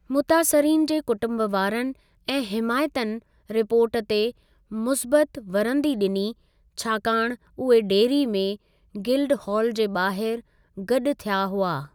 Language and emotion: Sindhi, neutral